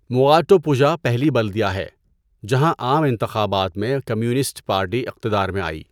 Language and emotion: Urdu, neutral